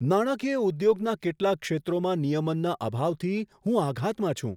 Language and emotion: Gujarati, surprised